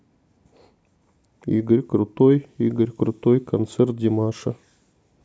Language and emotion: Russian, neutral